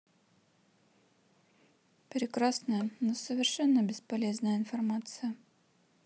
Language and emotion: Russian, neutral